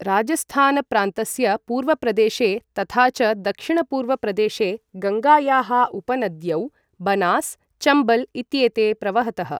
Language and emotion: Sanskrit, neutral